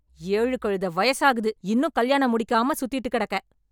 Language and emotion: Tamil, angry